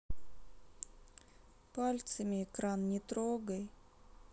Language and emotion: Russian, sad